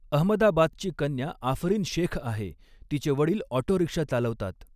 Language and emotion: Marathi, neutral